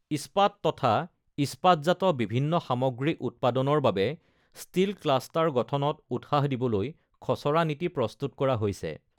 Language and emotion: Assamese, neutral